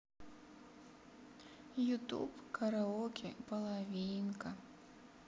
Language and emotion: Russian, sad